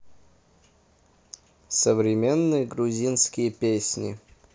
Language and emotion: Russian, neutral